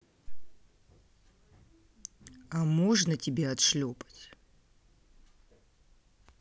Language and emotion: Russian, neutral